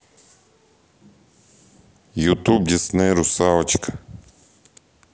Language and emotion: Russian, neutral